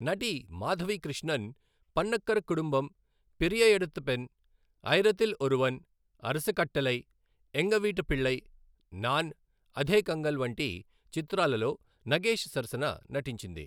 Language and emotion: Telugu, neutral